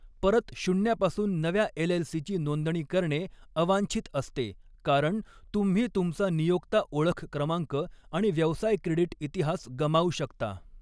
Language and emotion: Marathi, neutral